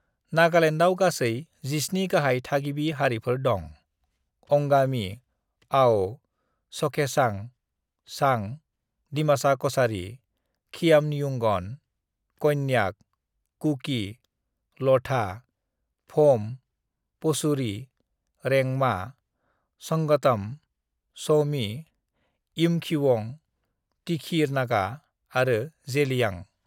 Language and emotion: Bodo, neutral